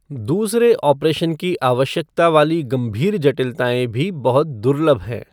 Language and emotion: Hindi, neutral